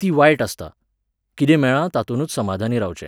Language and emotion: Goan Konkani, neutral